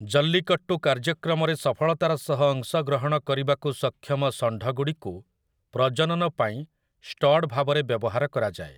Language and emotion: Odia, neutral